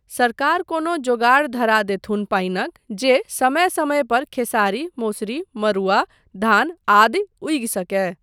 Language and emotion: Maithili, neutral